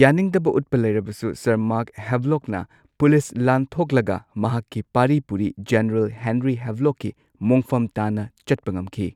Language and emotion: Manipuri, neutral